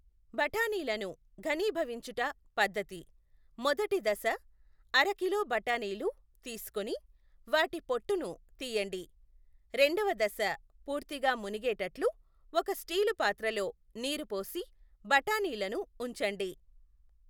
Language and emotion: Telugu, neutral